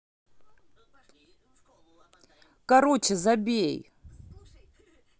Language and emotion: Russian, angry